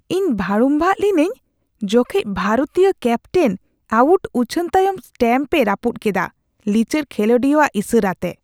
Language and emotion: Santali, disgusted